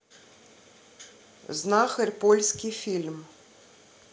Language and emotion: Russian, neutral